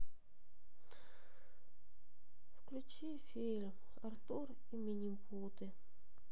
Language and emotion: Russian, sad